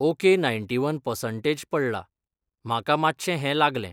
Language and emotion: Goan Konkani, neutral